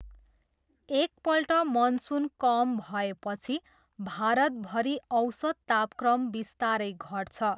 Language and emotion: Nepali, neutral